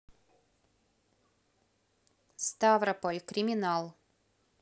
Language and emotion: Russian, neutral